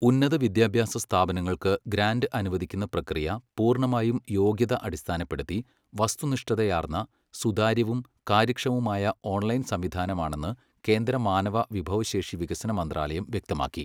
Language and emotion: Malayalam, neutral